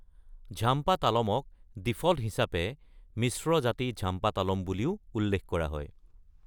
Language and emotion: Assamese, neutral